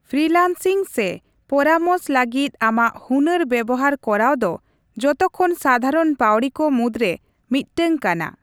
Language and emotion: Santali, neutral